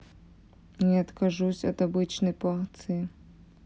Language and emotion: Russian, neutral